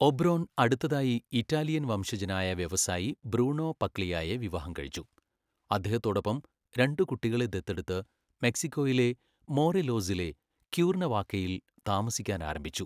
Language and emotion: Malayalam, neutral